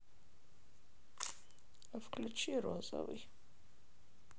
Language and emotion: Russian, sad